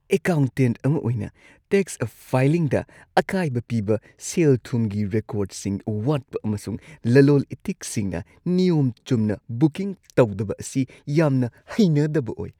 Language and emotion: Manipuri, disgusted